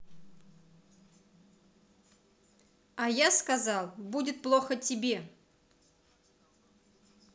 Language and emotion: Russian, neutral